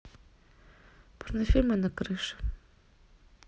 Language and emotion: Russian, neutral